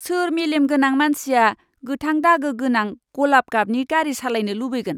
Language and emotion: Bodo, disgusted